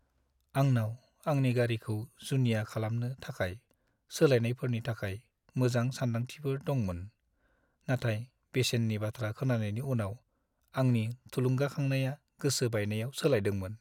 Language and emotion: Bodo, sad